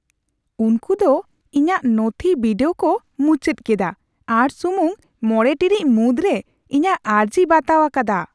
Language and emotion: Santali, surprised